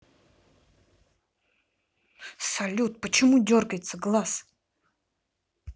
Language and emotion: Russian, angry